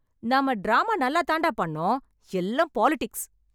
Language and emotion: Tamil, angry